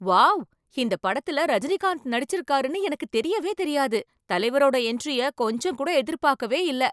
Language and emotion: Tamil, surprised